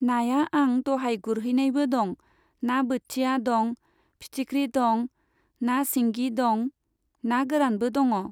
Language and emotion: Bodo, neutral